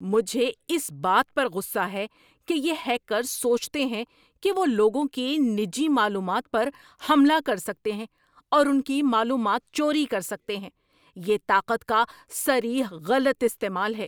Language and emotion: Urdu, angry